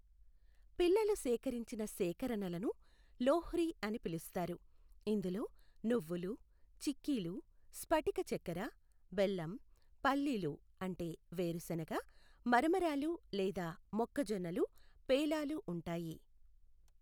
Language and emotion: Telugu, neutral